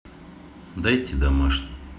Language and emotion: Russian, neutral